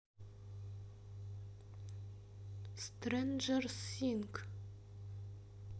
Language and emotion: Russian, neutral